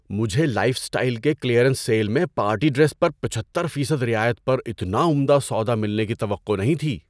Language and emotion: Urdu, surprised